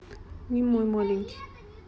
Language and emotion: Russian, neutral